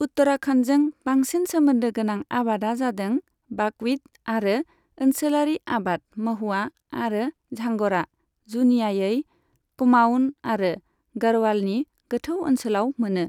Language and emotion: Bodo, neutral